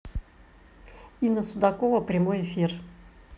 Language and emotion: Russian, neutral